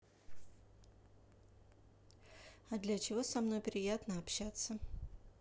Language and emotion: Russian, neutral